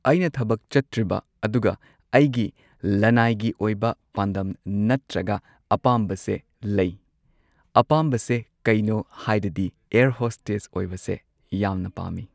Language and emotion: Manipuri, neutral